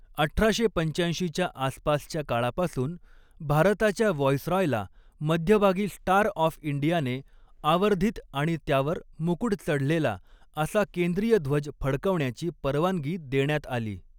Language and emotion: Marathi, neutral